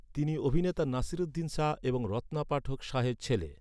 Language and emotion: Bengali, neutral